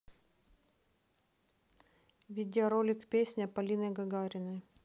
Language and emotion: Russian, neutral